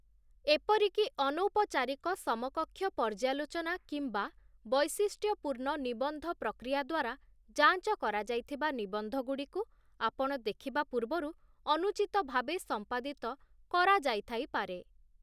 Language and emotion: Odia, neutral